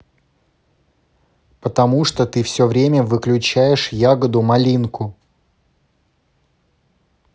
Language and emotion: Russian, angry